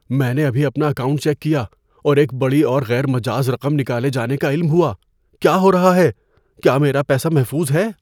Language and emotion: Urdu, fearful